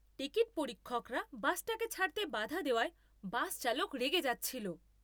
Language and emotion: Bengali, angry